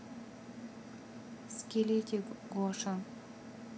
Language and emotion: Russian, neutral